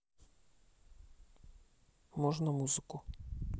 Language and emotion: Russian, neutral